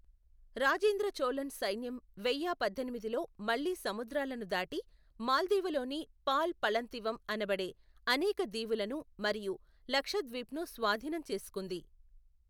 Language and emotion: Telugu, neutral